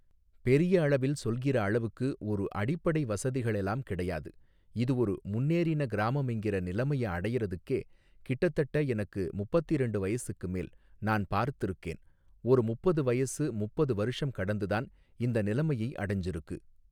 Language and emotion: Tamil, neutral